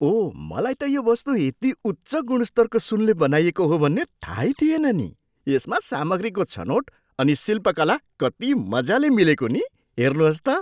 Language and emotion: Nepali, surprised